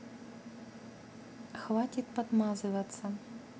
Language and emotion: Russian, neutral